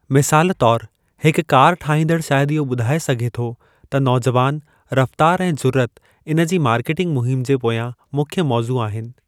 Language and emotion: Sindhi, neutral